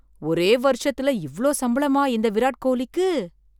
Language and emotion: Tamil, surprised